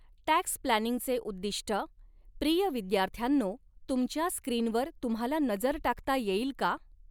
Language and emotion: Marathi, neutral